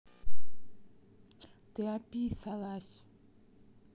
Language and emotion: Russian, neutral